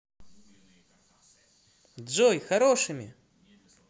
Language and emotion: Russian, positive